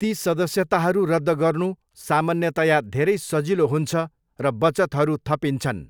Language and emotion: Nepali, neutral